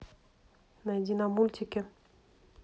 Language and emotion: Russian, neutral